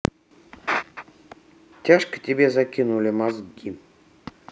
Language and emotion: Russian, neutral